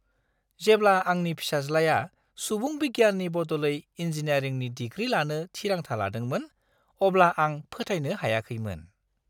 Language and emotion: Bodo, surprised